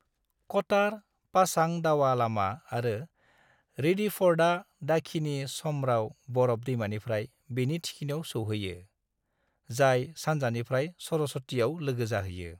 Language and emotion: Bodo, neutral